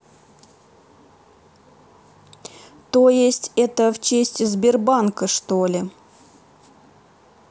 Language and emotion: Russian, neutral